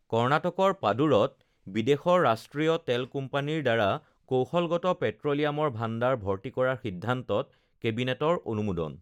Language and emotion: Assamese, neutral